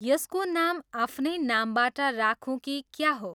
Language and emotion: Nepali, neutral